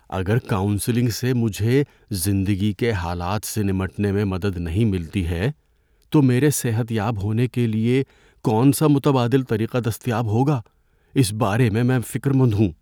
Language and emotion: Urdu, fearful